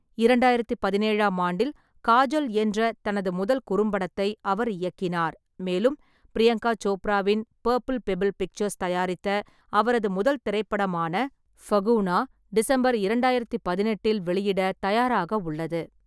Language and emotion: Tamil, neutral